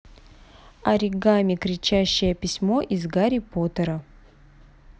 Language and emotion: Russian, neutral